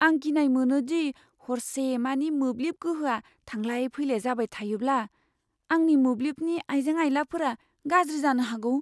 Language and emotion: Bodo, fearful